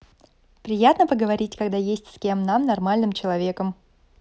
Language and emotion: Russian, positive